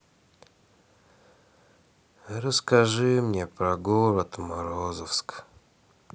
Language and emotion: Russian, sad